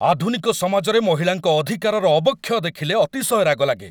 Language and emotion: Odia, angry